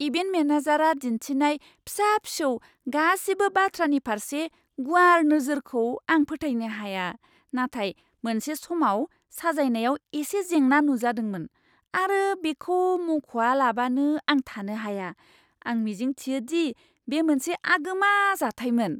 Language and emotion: Bodo, surprised